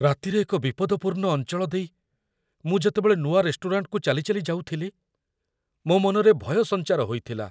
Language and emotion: Odia, fearful